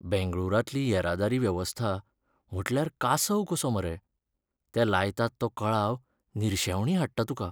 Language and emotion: Goan Konkani, sad